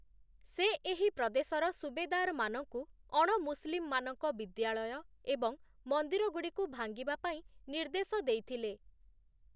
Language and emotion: Odia, neutral